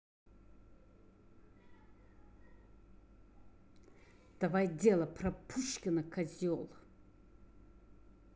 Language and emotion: Russian, angry